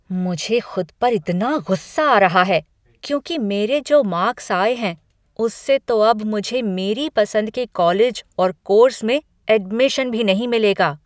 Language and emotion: Hindi, angry